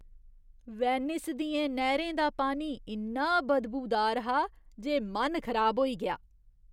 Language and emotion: Dogri, disgusted